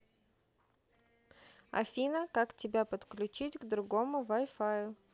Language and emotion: Russian, neutral